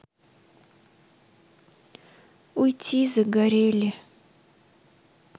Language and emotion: Russian, sad